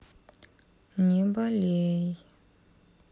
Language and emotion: Russian, sad